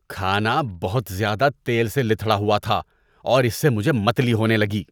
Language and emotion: Urdu, disgusted